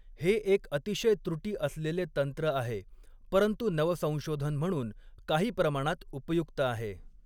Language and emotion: Marathi, neutral